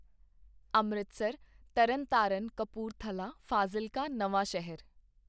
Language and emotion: Punjabi, neutral